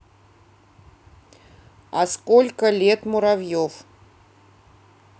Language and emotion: Russian, neutral